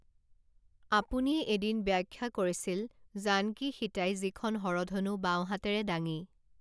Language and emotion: Assamese, neutral